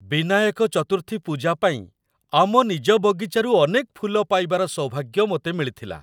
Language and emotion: Odia, happy